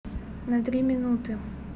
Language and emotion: Russian, neutral